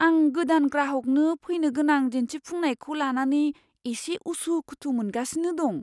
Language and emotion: Bodo, fearful